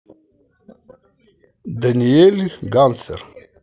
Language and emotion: Russian, positive